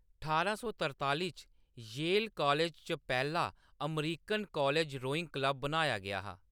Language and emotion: Dogri, neutral